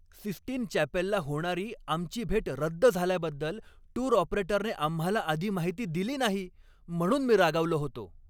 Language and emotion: Marathi, angry